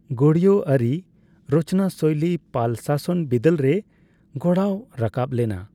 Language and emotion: Santali, neutral